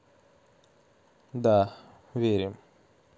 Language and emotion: Russian, neutral